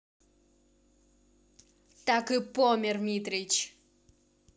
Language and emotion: Russian, angry